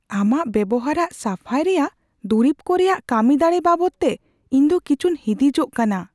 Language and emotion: Santali, fearful